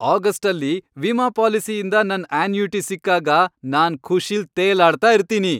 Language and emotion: Kannada, happy